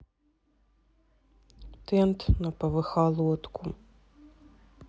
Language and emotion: Russian, sad